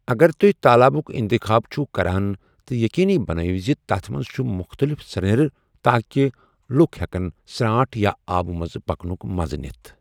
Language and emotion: Kashmiri, neutral